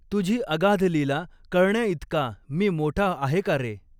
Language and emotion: Marathi, neutral